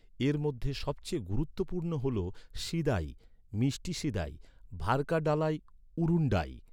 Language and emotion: Bengali, neutral